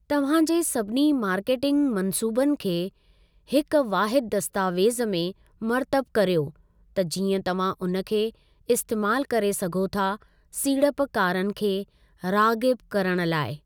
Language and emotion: Sindhi, neutral